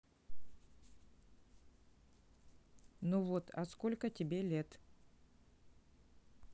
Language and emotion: Russian, neutral